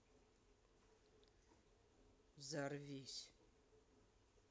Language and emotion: Russian, neutral